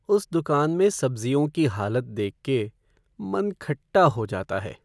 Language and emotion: Hindi, sad